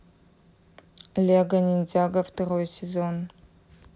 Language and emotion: Russian, neutral